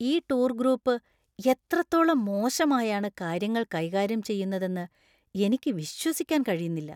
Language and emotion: Malayalam, disgusted